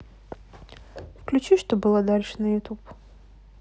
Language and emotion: Russian, neutral